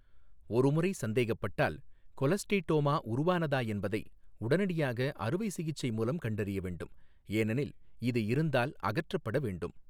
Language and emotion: Tamil, neutral